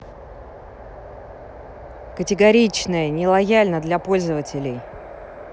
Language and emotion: Russian, angry